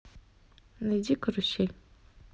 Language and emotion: Russian, neutral